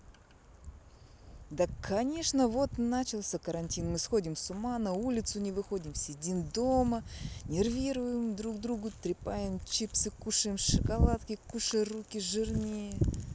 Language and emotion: Russian, neutral